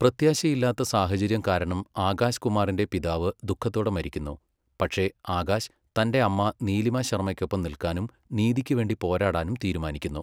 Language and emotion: Malayalam, neutral